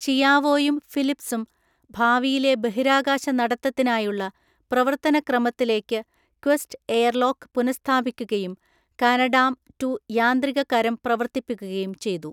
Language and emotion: Malayalam, neutral